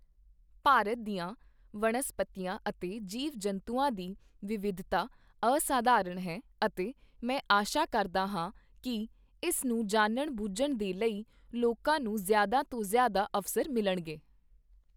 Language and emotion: Punjabi, neutral